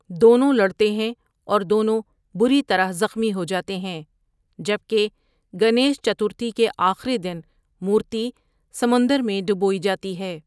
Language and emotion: Urdu, neutral